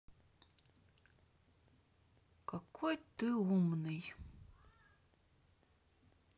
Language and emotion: Russian, positive